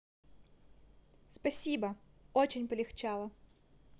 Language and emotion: Russian, positive